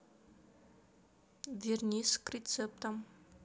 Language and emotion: Russian, neutral